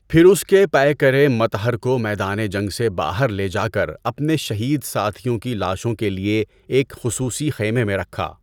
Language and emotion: Urdu, neutral